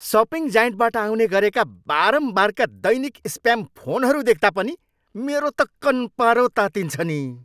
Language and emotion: Nepali, angry